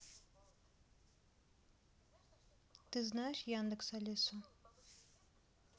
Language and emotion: Russian, neutral